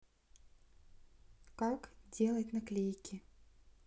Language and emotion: Russian, neutral